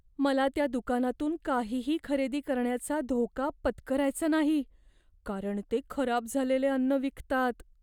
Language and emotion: Marathi, fearful